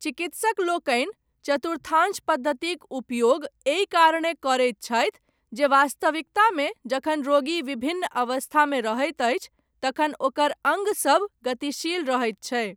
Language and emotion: Maithili, neutral